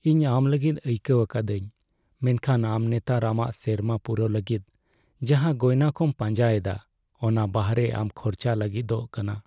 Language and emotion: Santali, sad